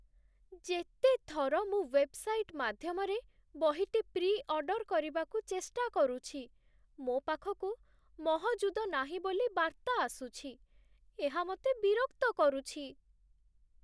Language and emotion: Odia, sad